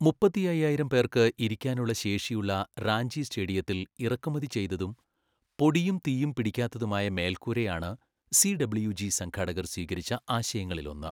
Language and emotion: Malayalam, neutral